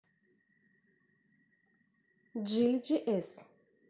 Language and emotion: Russian, neutral